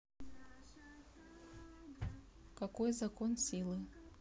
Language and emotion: Russian, neutral